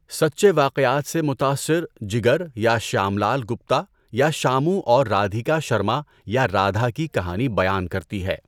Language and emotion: Urdu, neutral